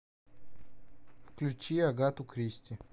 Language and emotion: Russian, neutral